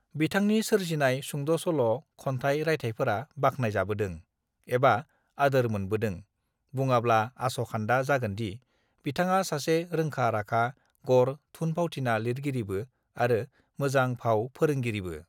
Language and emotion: Bodo, neutral